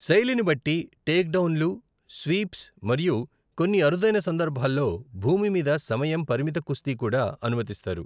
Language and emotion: Telugu, neutral